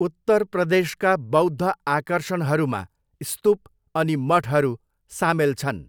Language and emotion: Nepali, neutral